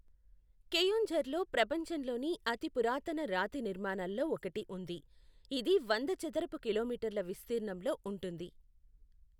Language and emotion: Telugu, neutral